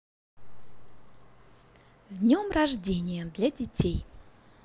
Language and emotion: Russian, positive